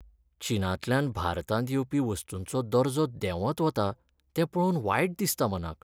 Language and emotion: Goan Konkani, sad